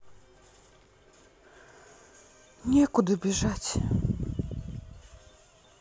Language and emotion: Russian, sad